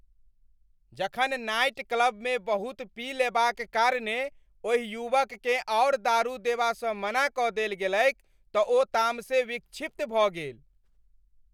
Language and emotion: Maithili, angry